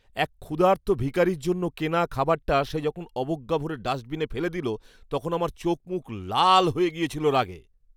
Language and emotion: Bengali, angry